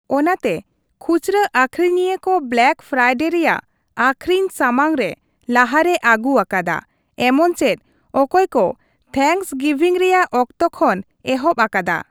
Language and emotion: Santali, neutral